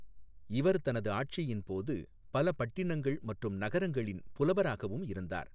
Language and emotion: Tamil, neutral